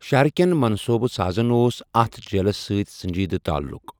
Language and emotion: Kashmiri, neutral